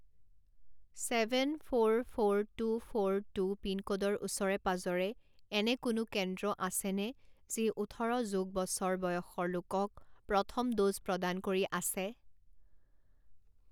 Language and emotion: Assamese, neutral